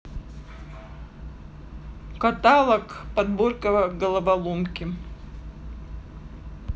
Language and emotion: Russian, neutral